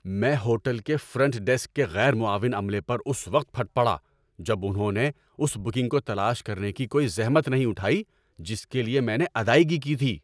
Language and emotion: Urdu, angry